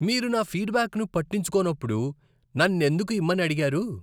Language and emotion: Telugu, disgusted